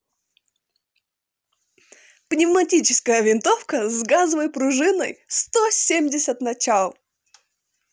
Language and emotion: Russian, positive